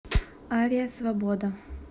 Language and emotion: Russian, neutral